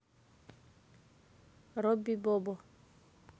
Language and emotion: Russian, neutral